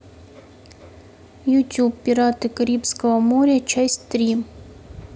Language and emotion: Russian, neutral